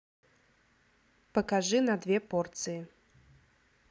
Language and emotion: Russian, neutral